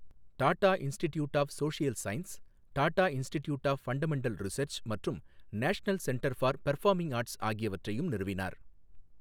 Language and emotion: Tamil, neutral